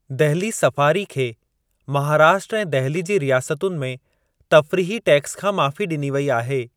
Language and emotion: Sindhi, neutral